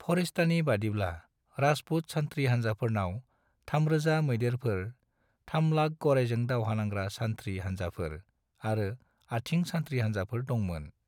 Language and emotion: Bodo, neutral